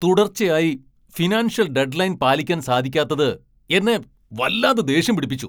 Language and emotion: Malayalam, angry